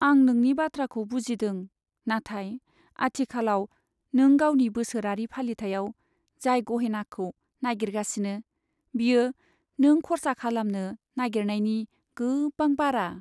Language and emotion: Bodo, sad